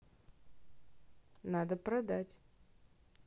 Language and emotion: Russian, neutral